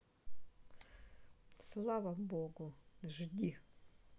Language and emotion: Russian, neutral